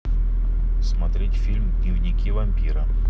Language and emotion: Russian, neutral